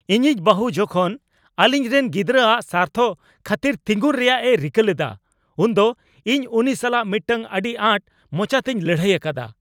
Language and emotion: Santali, angry